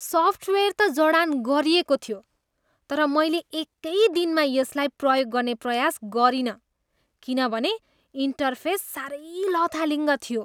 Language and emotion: Nepali, disgusted